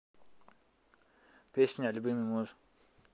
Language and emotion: Russian, neutral